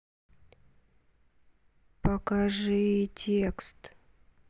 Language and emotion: Russian, sad